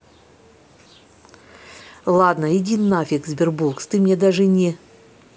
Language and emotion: Russian, angry